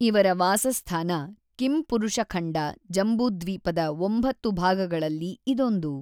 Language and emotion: Kannada, neutral